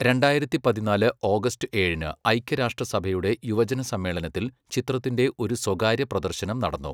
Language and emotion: Malayalam, neutral